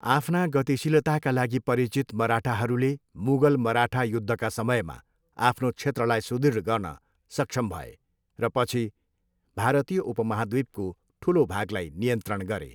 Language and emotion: Nepali, neutral